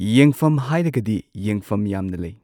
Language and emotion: Manipuri, neutral